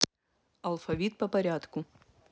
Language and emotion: Russian, neutral